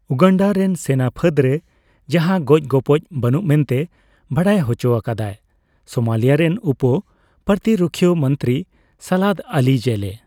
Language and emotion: Santali, neutral